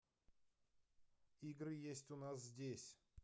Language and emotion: Russian, neutral